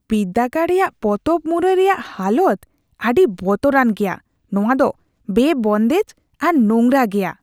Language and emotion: Santali, disgusted